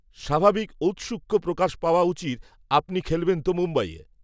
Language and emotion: Bengali, neutral